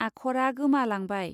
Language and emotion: Bodo, neutral